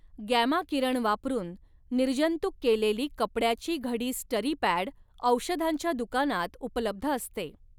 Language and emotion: Marathi, neutral